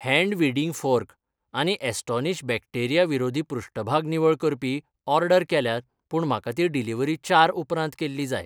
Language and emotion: Goan Konkani, neutral